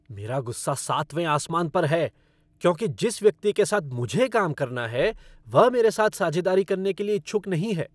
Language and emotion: Hindi, angry